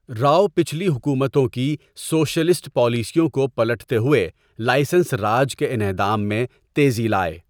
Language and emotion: Urdu, neutral